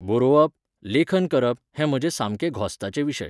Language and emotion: Goan Konkani, neutral